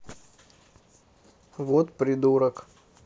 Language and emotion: Russian, neutral